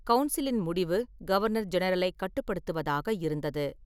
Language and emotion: Tamil, neutral